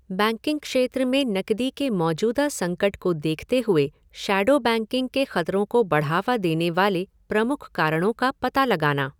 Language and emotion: Hindi, neutral